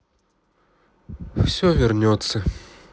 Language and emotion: Russian, sad